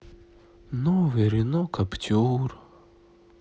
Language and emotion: Russian, sad